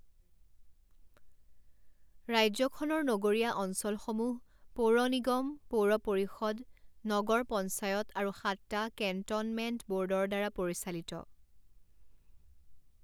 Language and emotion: Assamese, neutral